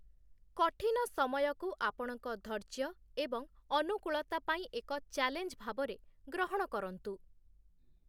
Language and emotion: Odia, neutral